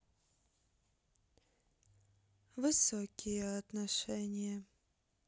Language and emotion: Russian, sad